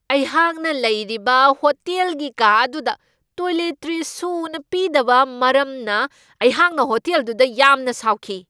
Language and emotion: Manipuri, angry